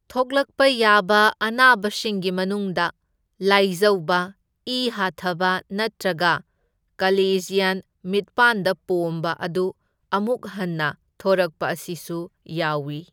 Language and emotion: Manipuri, neutral